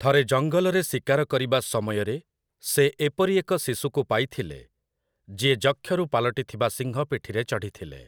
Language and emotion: Odia, neutral